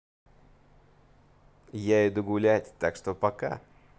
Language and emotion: Russian, positive